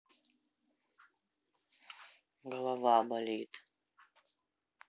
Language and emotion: Russian, sad